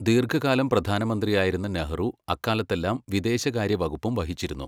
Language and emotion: Malayalam, neutral